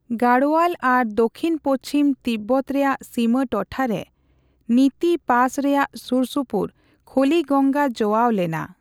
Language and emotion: Santali, neutral